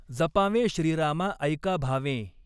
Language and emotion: Marathi, neutral